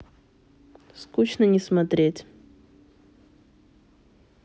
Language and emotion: Russian, sad